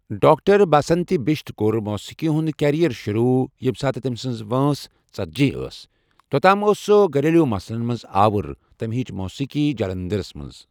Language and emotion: Kashmiri, neutral